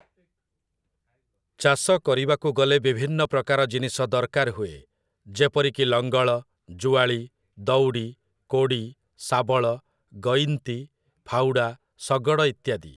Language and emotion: Odia, neutral